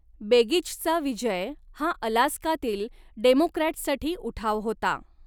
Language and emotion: Marathi, neutral